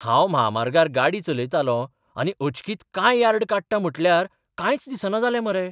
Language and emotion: Goan Konkani, surprised